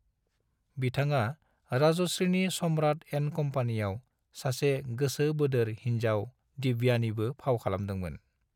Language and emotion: Bodo, neutral